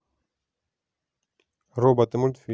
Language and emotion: Russian, neutral